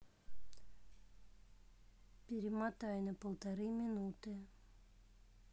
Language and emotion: Russian, neutral